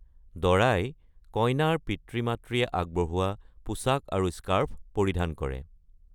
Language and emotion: Assamese, neutral